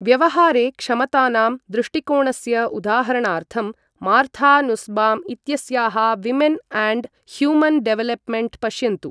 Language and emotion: Sanskrit, neutral